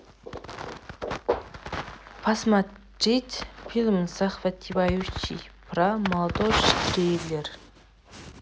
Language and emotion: Russian, neutral